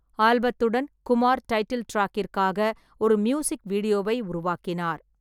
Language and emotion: Tamil, neutral